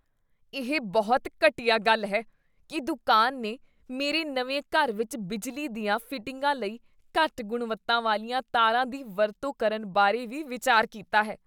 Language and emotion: Punjabi, disgusted